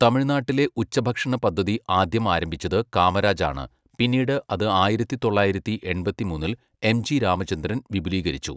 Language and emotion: Malayalam, neutral